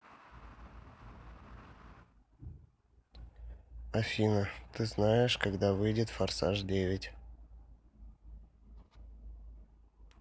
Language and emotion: Russian, neutral